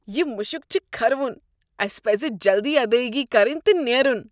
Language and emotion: Kashmiri, disgusted